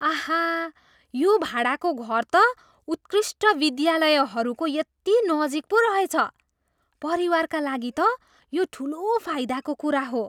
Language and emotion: Nepali, surprised